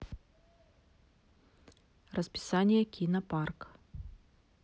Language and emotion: Russian, neutral